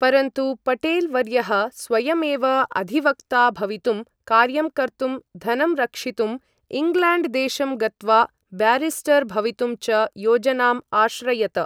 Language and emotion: Sanskrit, neutral